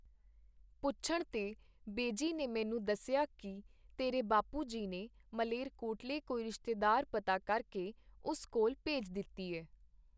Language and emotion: Punjabi, neutral